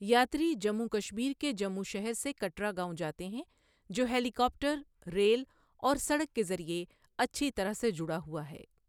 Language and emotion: Urdu, neutral